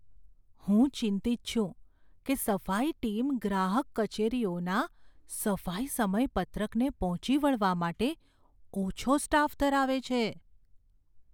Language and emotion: Gujarati, fearful